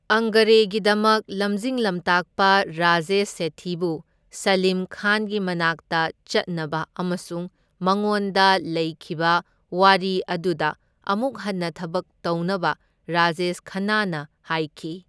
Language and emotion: Manipuri, neutral